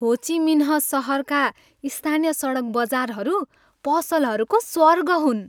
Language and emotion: Nepali, happy